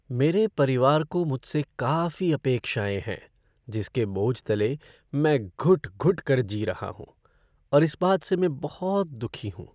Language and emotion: Hindi, sad